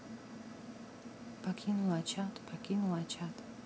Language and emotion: Russian, neutral